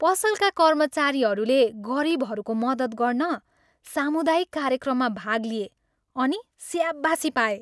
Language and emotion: Nepali, happy